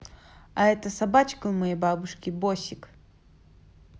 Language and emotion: Russian, positive